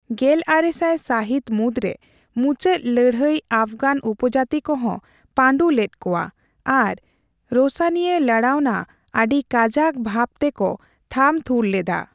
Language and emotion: Santali, neutral